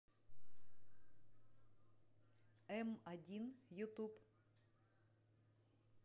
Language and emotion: Russian, neutral